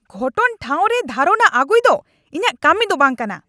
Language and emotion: Santali, angry